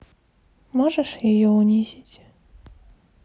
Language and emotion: Russian, sad